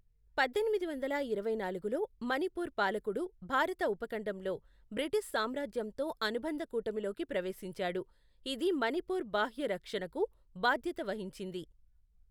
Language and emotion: Telugu, neutral